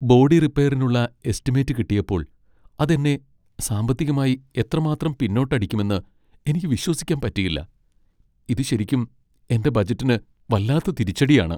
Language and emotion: Malayalam, sad